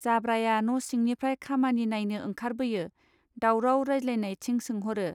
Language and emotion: Bodo, neutral